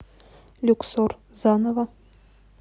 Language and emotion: Russian, neutral